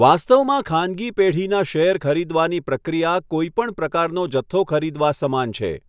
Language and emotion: Gujarati, neutral